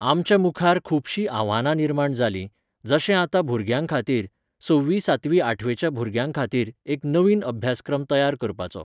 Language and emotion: Goan Konkani, neutral